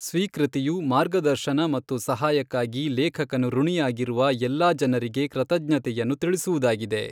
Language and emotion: Kannada, neutral